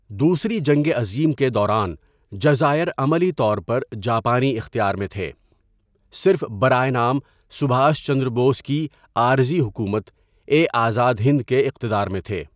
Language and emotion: Urdu, neutral